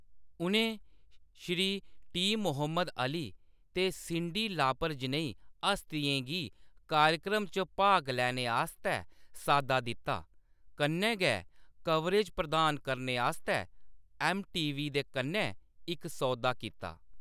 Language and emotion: Dogri, neutral